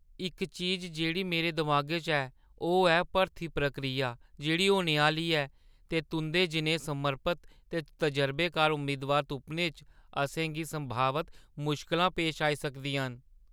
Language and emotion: Dogri, fearful